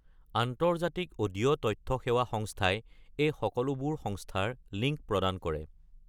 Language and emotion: Assamese, neutral